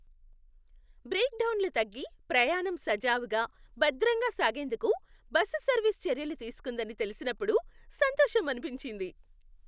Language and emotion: Telugu, happy